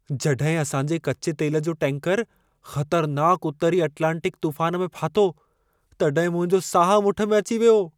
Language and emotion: Sindhi, fearful